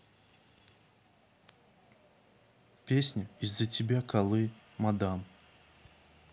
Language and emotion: Russian, neutral